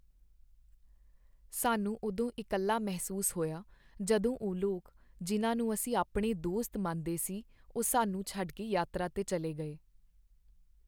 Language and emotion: Punjabi, sad